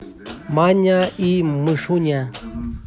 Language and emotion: Russian, neutral